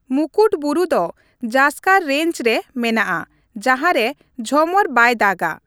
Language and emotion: Santali, neutral